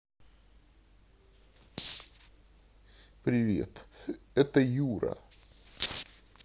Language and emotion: Russian, neutral